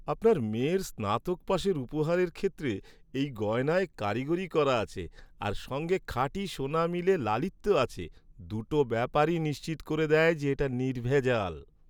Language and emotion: Bengali, happy